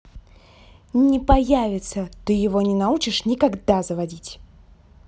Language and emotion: Russian, angry